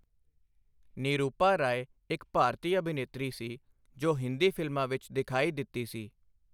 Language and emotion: Punjabi, neutral